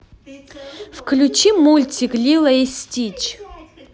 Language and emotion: Russian, positive